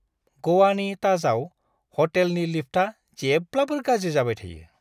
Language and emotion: Bodo, disgusted